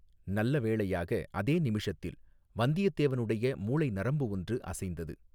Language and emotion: Tamil, neutral